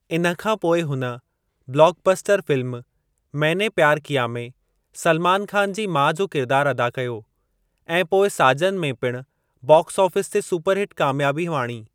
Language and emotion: Sindhi, neutral